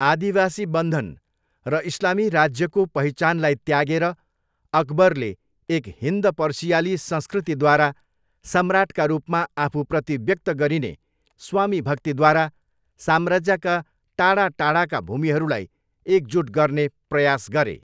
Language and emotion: Nepali, neutral